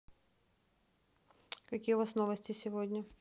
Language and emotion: Russian, neutral